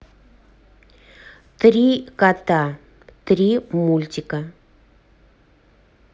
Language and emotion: Russian, neutral